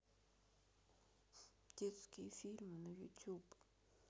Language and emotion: Russian, sad